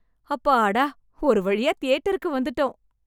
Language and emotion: Tamil, happy